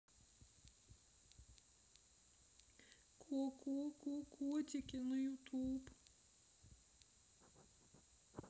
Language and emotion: Russian, sad